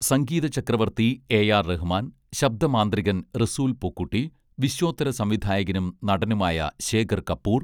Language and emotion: Malayalam, neutral